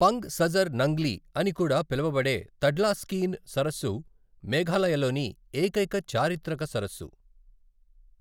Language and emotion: Telugu, neutral